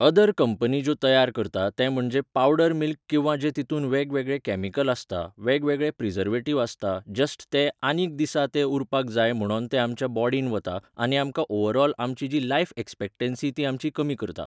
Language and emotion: Goan Konkani, neutral